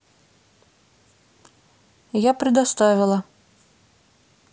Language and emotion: Russian, neutral